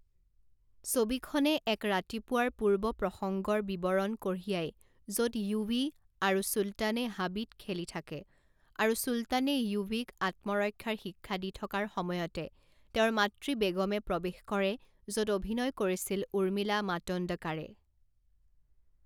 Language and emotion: Assamese, neutral